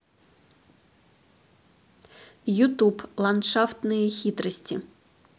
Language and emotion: Russian, neutral